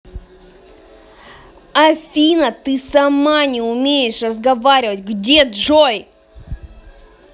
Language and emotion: Russian, angry